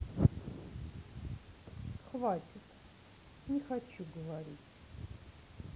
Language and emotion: Russian, sad